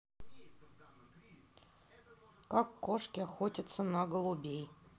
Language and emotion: Russian, neutral